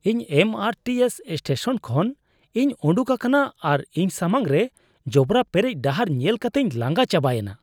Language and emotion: Santali, disgusted